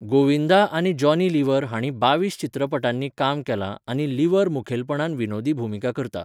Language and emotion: Goan Konkani, neutral